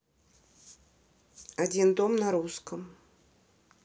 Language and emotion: Russian, neutral